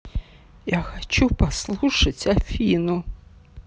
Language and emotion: Russian, sad